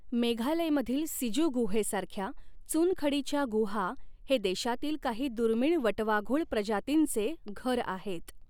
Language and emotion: Marathi, neutral